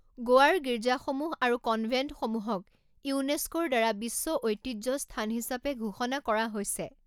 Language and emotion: Assamese, neutral